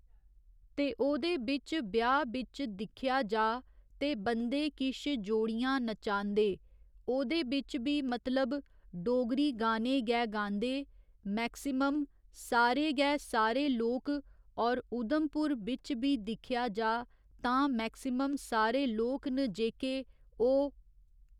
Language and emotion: Dogri, neutral